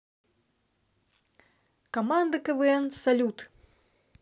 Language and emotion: Russian, neutral